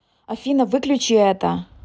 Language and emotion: Russian, angry